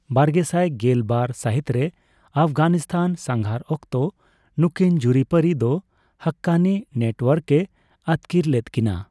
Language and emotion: Santali, neutral